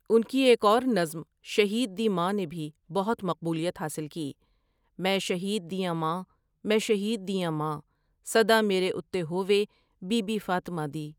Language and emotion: Urdu, neutral